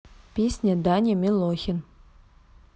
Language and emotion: Russian, neutral